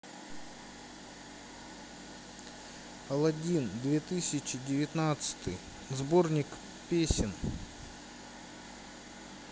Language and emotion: Russian, sad